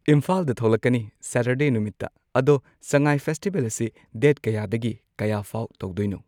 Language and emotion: Manipuri, neutral